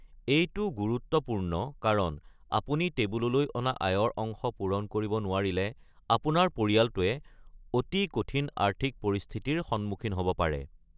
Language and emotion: Assamese, neutral